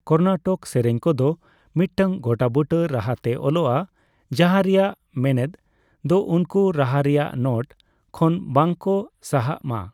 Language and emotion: Santali, neutral